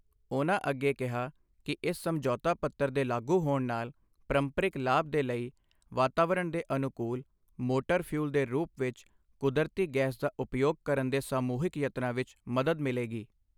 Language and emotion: Punjabi, neutral